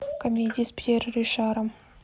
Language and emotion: Russian, neutral